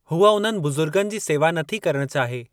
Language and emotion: Sindhi, neutral